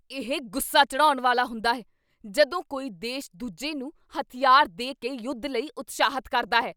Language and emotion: Punjabi, angry